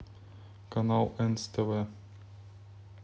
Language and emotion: Russian, neutral